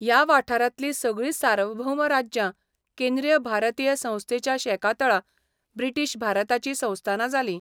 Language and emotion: Goan Konkani, neutral